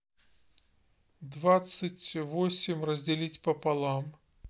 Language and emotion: Russian, neutral